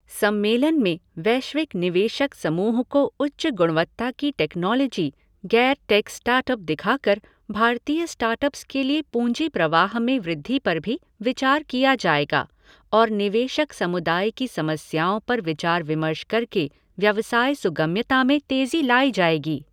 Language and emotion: Hindi, neutral